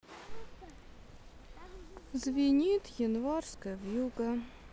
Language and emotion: Russian, sad